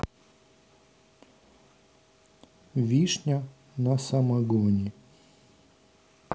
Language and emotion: Russian, neutral